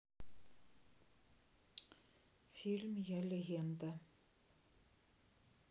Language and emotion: Russian, neutral